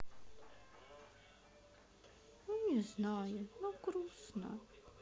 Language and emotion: Russian, sad